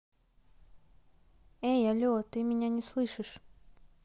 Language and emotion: Russian, neutral